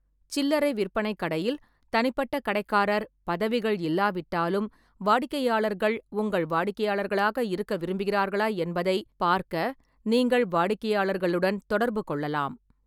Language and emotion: Tamil, neutral